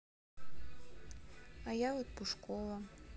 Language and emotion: Russian, sad